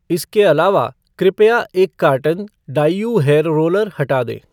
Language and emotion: Hindi, neutral